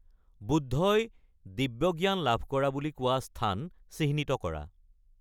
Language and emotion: Assamese, neutral